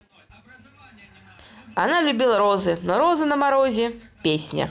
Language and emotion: Russian, positive